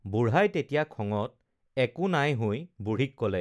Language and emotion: Assamese, neutral